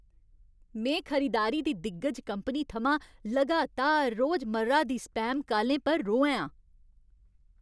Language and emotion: Dogri, angry